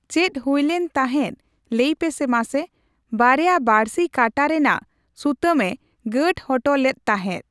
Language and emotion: Santali, neutral